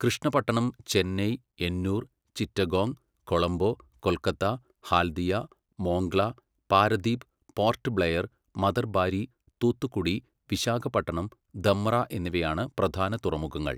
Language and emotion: Malayalam, neutral